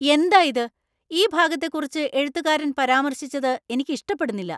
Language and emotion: Malayalam, angry